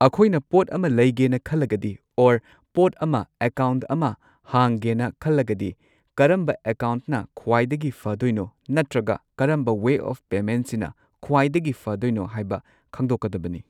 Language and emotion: Manipuri, neutral